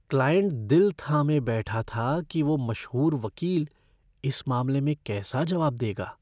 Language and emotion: Hindi, fearful